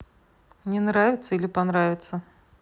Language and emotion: Russian, neutral